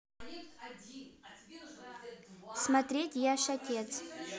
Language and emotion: Russian, neutral